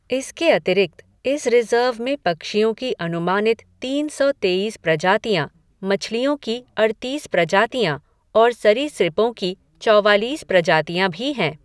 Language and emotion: Hindi, neutral